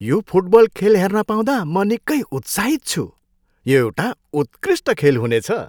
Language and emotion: Nepali, happy